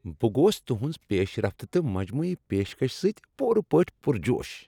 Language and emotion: Kashmiri, happy